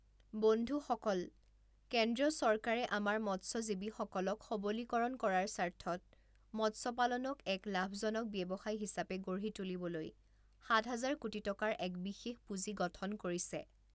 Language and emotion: Assamese, neutral